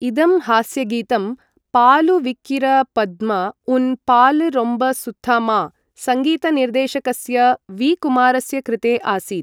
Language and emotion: Sanskrit, neutral